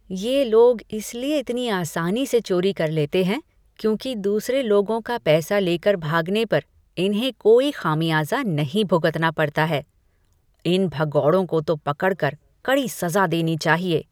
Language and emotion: Hindi, disgusted